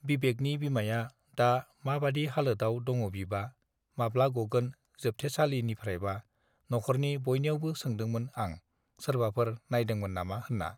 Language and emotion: Bodo, neutral